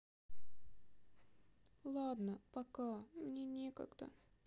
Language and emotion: Russian, sad